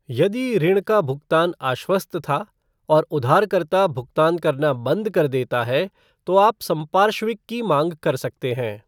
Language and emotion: Hindi, neutral